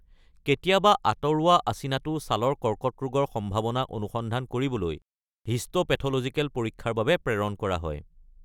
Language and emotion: Assamese, neutral